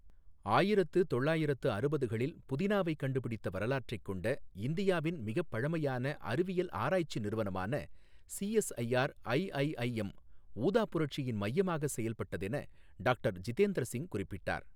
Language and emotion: Tamil, neutral